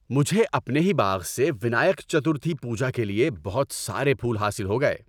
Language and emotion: Urdu, happy